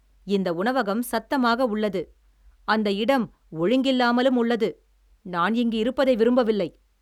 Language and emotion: Tamil, angry